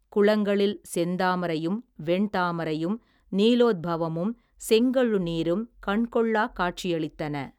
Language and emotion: Tamil, neutral